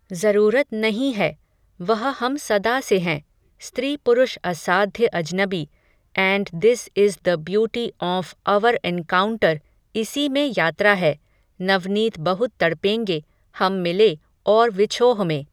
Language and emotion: Hindi, neutral